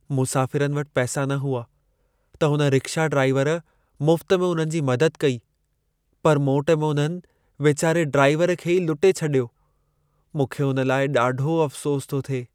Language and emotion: Sindhi, sad